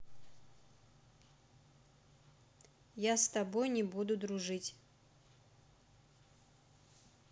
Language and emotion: Russian, neutral